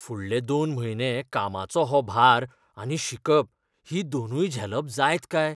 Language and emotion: Goan Konkani, fearful